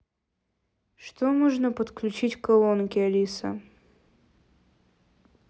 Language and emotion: Russian, neutral